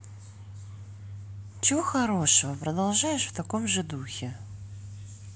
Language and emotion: Russian, neutral